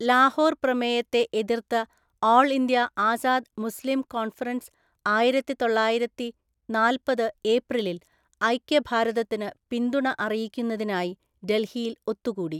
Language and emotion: Malayalam, neutral